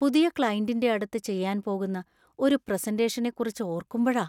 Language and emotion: Malayalam, fearful